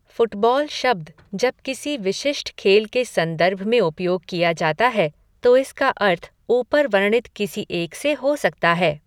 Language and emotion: Hindi, neutral